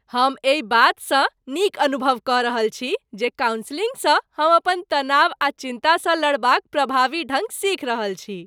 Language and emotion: Maithili, happy